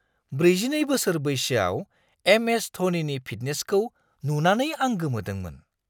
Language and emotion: Bodo, surprised